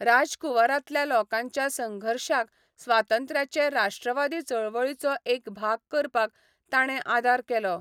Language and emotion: Goan Konkani, neutral